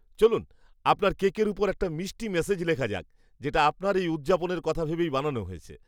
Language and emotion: Bengali, happy